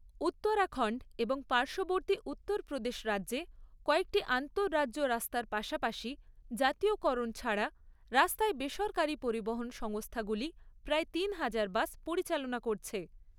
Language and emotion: Bengali, neutral